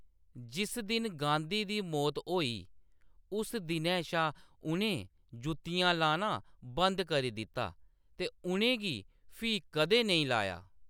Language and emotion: Dogri, neutral